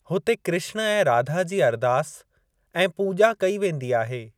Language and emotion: Sindhi, neutral